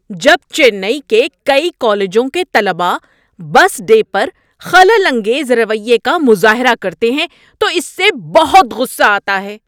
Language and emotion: Urdu, angry